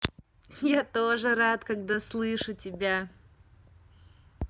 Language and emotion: Russian, positive